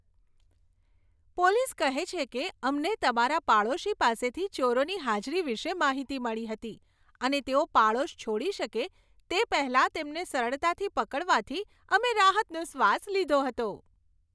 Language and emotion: Gujarati, happy